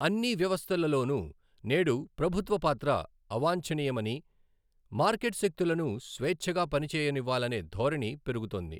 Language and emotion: Telugu, neutral